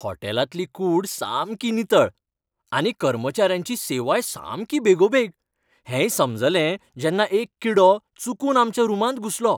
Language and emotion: Goan Konkani, happy